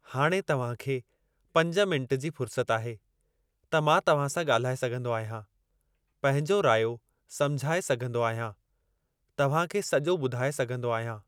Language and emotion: Sindhi, neutral